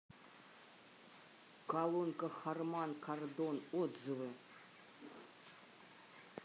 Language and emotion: Russian, neutral